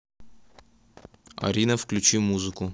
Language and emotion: Russian, neutral